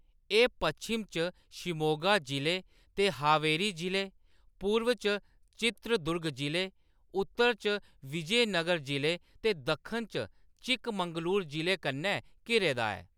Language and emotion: Dogri, neutral